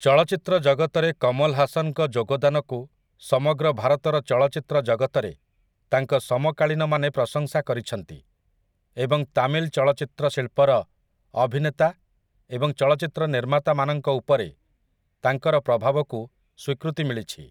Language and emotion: Odia, neutral